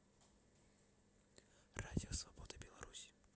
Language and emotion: Russian, neutral